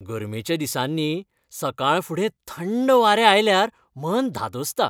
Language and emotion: Goan Konkani, happy